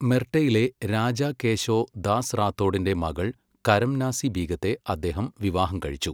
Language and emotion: Malayalam, neutral